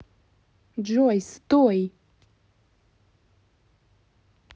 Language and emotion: Russian, angry